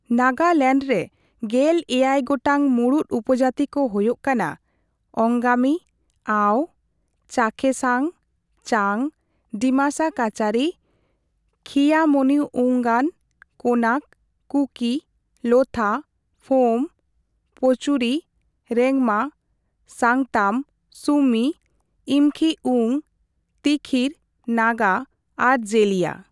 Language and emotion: Santali, neutral